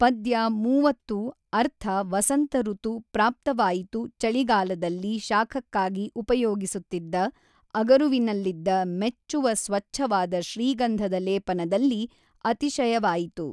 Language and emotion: Kannada, neutral